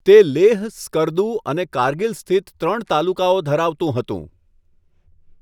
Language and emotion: Gujarati, neutral